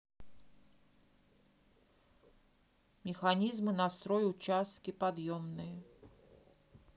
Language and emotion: Russian, neutral